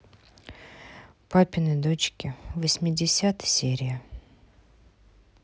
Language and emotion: Russian, sad